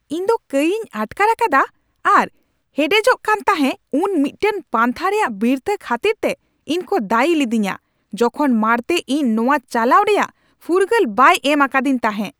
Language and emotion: Santali, angry